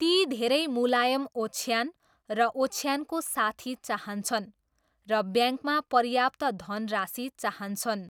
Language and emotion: Nepali, neutral